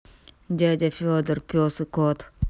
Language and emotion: Russian, angry